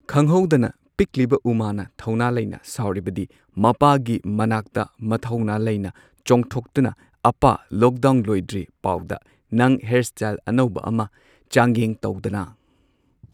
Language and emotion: Manipuri, neutral